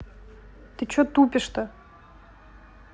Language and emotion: Russian, angry